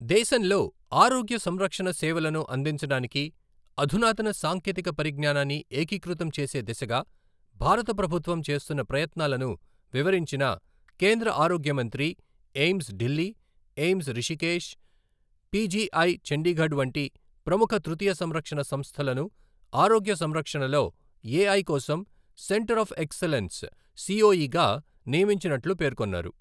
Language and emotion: Telugu, neutral